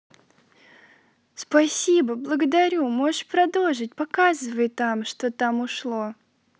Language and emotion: Russian, positive